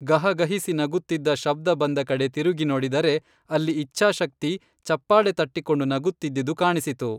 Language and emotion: Kannada, neutral